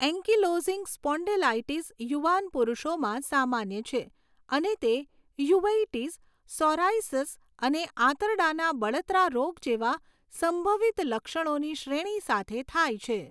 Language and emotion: Gujarati, neutral